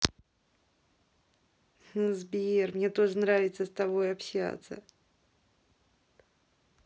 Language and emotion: Russian, positive